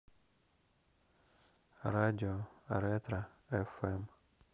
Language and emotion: Russian, neutral